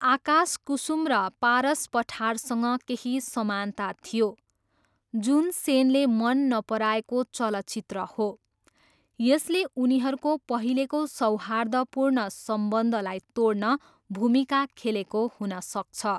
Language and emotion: Nepali, neutral